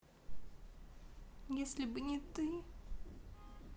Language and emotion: Russian, sad